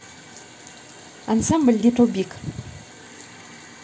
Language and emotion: Russian, neutral